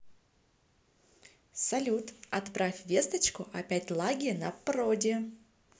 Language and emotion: Russian, positive